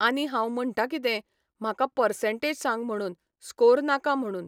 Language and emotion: Goan Konkani, neutral